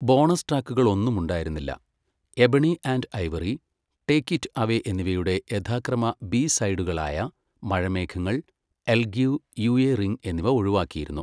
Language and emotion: Malayalam, neutral